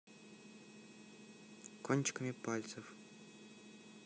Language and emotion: Russian, neutral